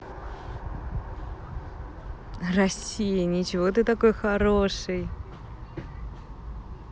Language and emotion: Russian, positive